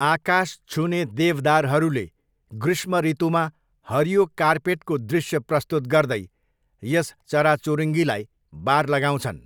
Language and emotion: Nepali, neutral